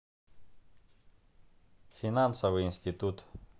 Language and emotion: Russian, neutral